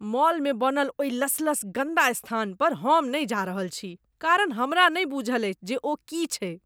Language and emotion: Maithili, disgusted